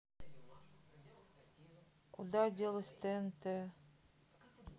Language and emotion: Russian, sad